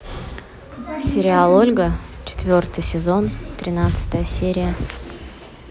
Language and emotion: Russian, neutral